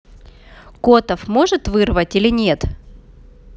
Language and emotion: Russian, neutral